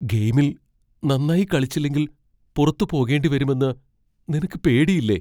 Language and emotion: Malayalam, fearful